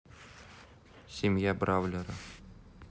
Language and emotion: Russian, neutral